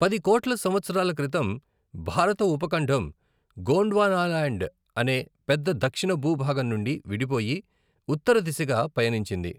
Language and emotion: Telugu, neutral